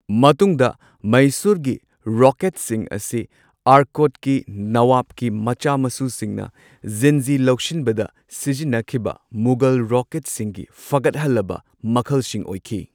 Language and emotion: Manipuri, neutral